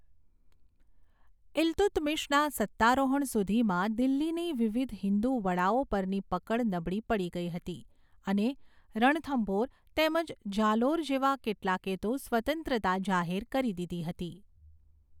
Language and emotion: Gujarati, neutral